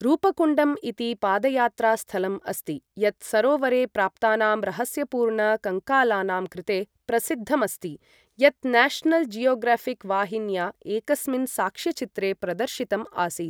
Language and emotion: Sanskrit, neutral